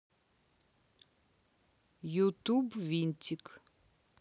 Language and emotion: Russian, neutral